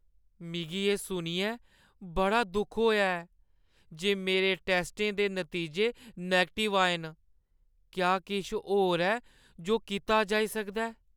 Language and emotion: Dogri, sad